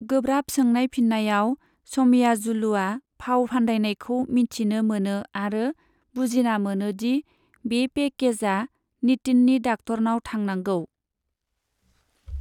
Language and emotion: Bodo, neutral